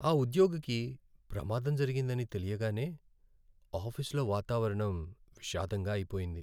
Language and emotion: Telugu, sad